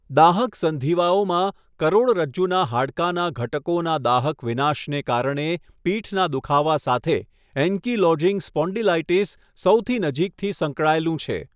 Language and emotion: Gujarati, neutral